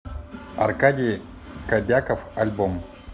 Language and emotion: Russian, neutral